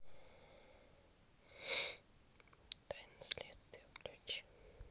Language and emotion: Russian, neutral